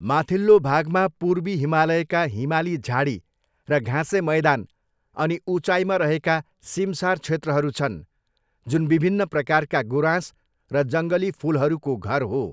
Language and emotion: Nepali, neutral